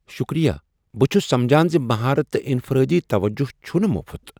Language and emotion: Kashmiri, surprised